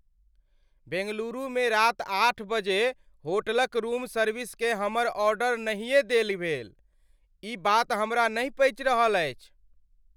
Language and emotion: Maithili, angry